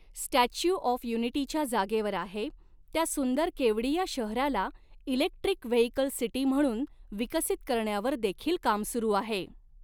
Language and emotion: Marathi, neutral